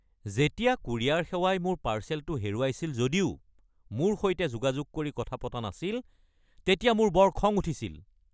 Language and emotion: Assamese, angry